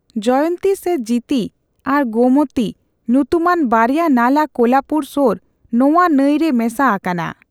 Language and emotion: Santali, neutral